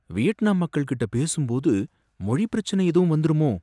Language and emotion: Tamil, fearful